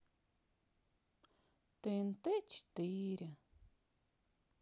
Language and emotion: Russian, sad